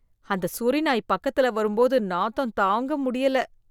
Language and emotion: Tamil, disgusted